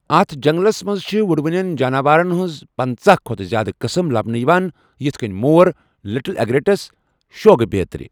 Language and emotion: Kashmiri, neutral